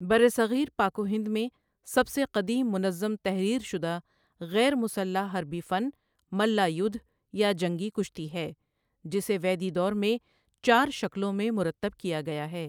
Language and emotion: Urdu, neutral